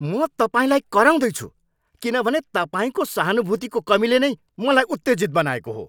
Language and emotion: Nepali, angry